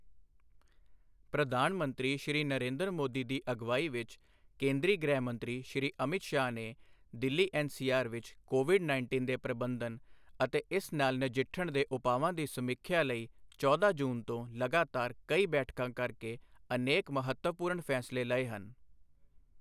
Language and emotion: Punjabi, neutral